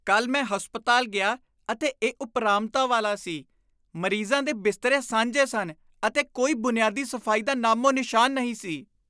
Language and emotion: Punjabi, disgusted